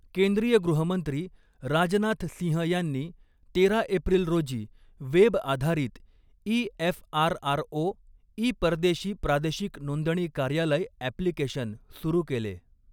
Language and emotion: Marathi, neutral